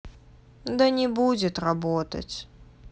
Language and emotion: Russian, sad